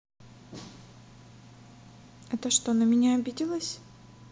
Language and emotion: Russian, neutral